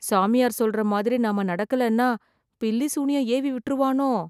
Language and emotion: Tamil, fearful